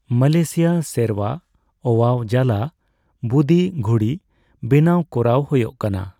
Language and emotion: Santali, neutral